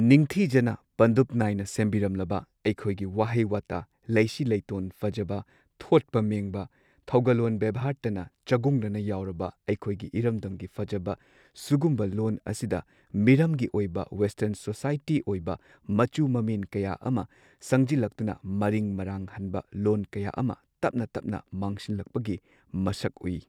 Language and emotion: Manipuri, neutral